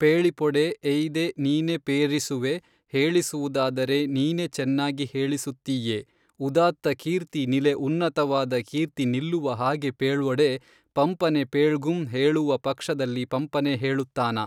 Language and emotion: Kannada, neutral